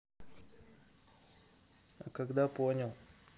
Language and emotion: Russian, neutral